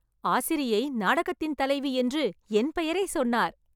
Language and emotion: Tamil, happy